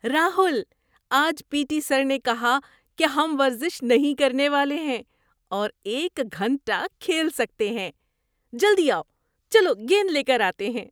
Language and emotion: Urdu, surprised